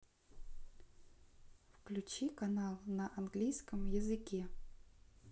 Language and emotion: Russian, neutral